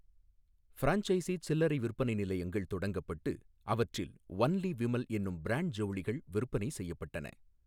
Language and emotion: Tamil, neutral